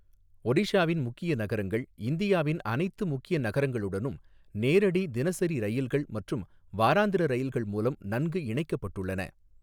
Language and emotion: Tamil, neutral